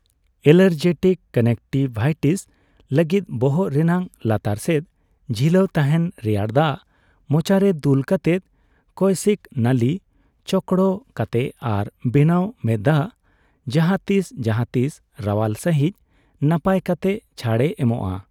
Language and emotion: Santali, neutral